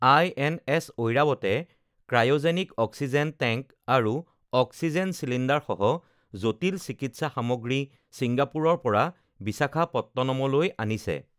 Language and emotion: Assamese, neutral